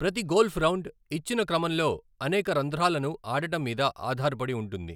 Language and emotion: Telugu, neutral